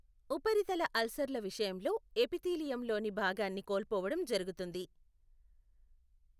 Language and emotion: Telugu, neutral